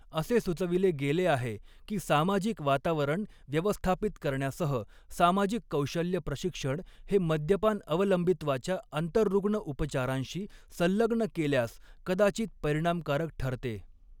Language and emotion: Marathi, neutral